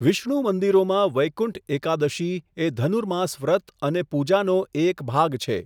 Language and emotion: Gujarati, neutral